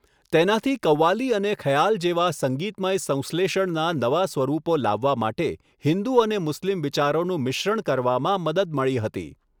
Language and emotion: Gujarati, neutral